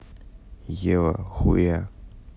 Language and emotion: Russian, neutral